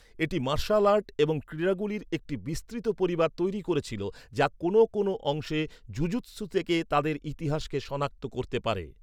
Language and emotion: Bengali, neutral